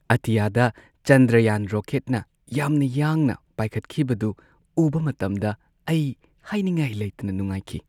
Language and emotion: Manipuri, happy